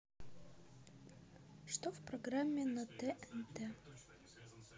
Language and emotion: Russian, neutral